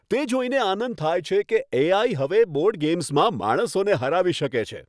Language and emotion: Gujarati, happy